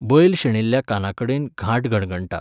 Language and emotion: Goan Konkani, neutral